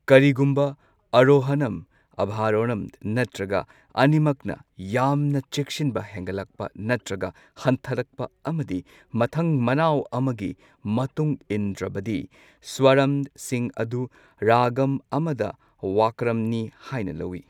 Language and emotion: Manipuri, neutral